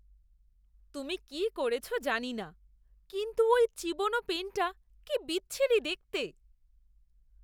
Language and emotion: Bengali, disgusted